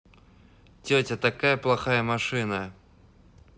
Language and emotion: Russian, neutral